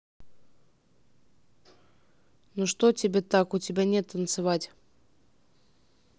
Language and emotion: Russian, neutral